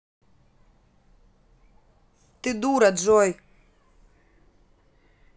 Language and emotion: Russian, angry